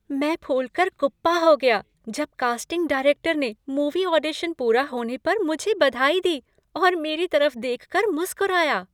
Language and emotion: Hindi, happy